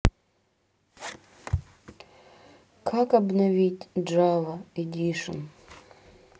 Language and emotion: Russian, sad